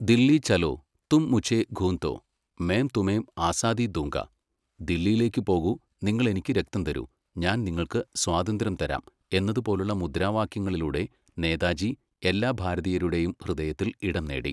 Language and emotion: Malayalam, neutral